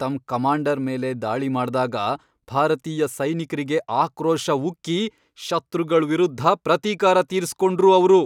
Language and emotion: Kannada, angry